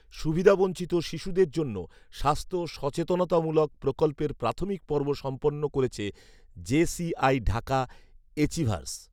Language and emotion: Bengali, neutral